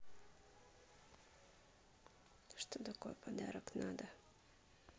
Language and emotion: Russian, neutral